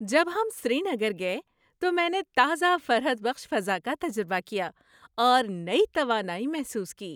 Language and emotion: Urdu, happy